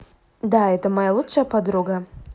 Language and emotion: Russian, positive